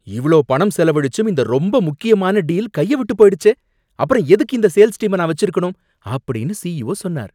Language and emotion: Tamil, angry